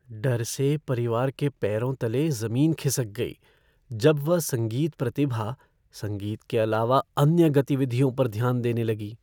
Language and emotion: Hindi, fearful